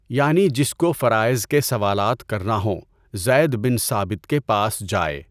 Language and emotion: Urdu, neutral